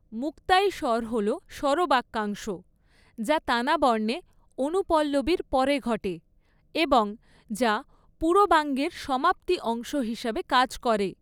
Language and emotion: Bengali, neutral